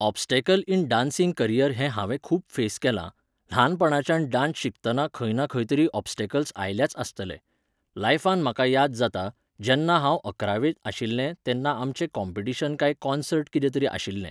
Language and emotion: Goan Konkani, neutral